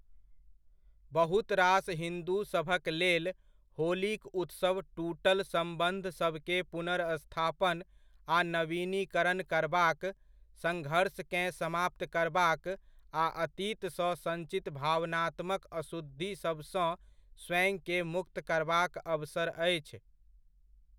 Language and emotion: Maithili, neutral